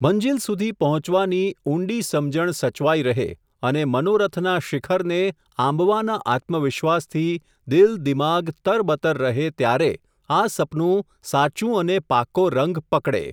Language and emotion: Gujarati, neutral